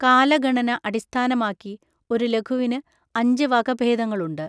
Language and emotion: Malayalam, neutral